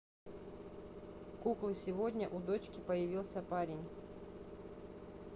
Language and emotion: Russian, neutral